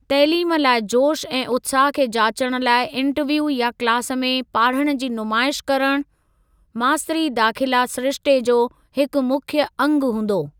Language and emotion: Sindhi, neutral